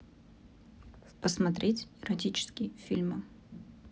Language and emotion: Russian, neutral